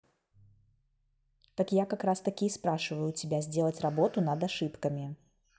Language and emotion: Russian, neutral